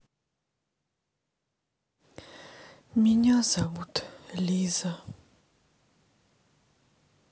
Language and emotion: Russian, sad